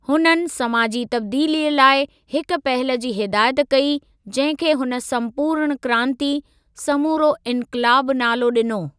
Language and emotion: Sindhi, neutral